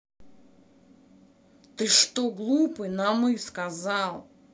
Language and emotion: Russian, angry